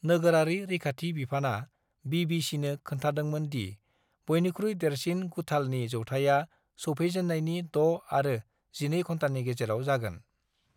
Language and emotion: Bodo, neutral